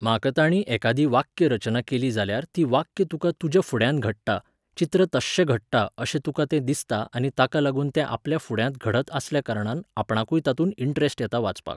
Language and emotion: Goan Konkani, neutral